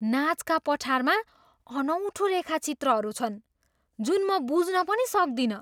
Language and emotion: Nepali, surprised